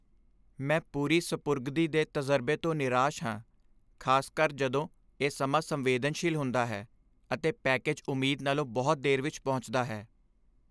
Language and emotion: Punjabi, sad